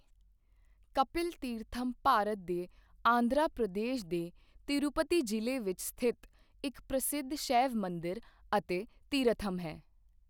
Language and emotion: Punjabi, neutral